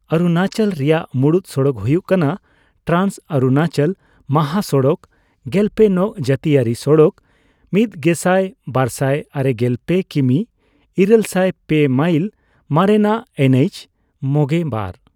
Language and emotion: Santali, neutral